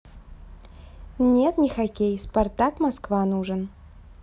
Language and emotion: Russian, neutral